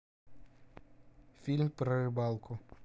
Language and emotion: Russian, neutral